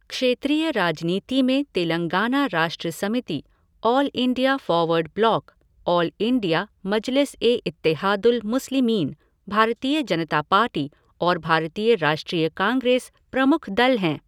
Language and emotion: Hindi, neutral